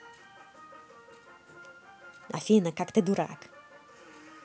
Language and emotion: Russian, positive